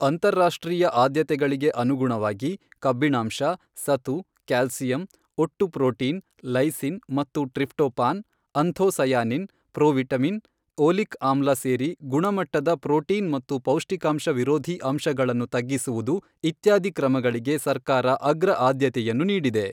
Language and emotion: Kannada, neutral